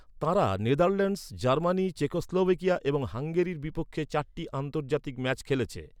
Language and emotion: Bengali, neutral